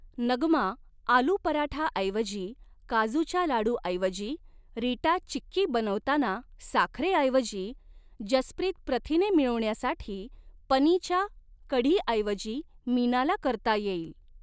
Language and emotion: Marathi, neutral